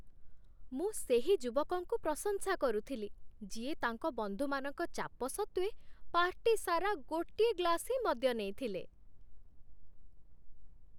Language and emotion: Odia, happy